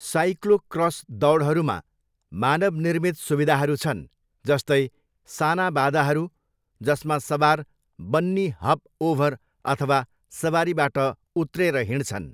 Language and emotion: Nepali, neutral